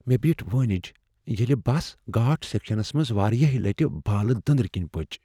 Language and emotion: Kashmiri, fearful